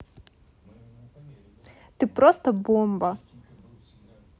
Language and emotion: Russian, positive